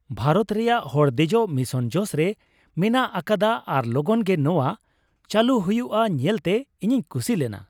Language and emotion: Santali, happy